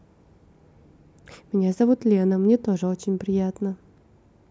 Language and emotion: Russian, positive